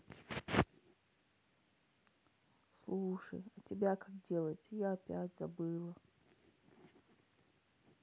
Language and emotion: Russian, sad